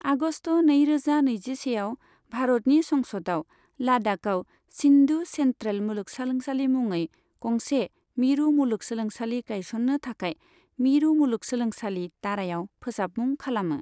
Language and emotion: Bodo, neutral